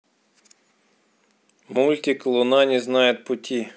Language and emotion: Russian, neutral